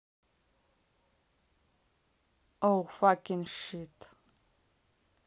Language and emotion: Russian, neutral